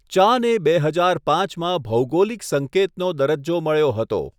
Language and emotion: Gujarati, neutral